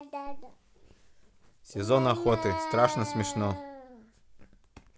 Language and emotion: Russian, neutral